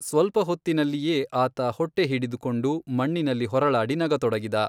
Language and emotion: Kannada, neutral